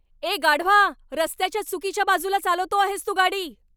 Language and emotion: Marathi, angry